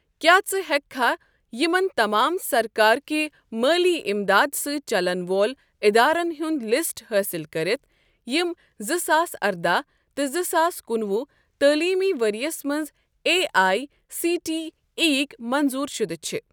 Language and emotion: Kashmiri, neutral